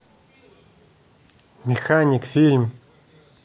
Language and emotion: Russian, neutral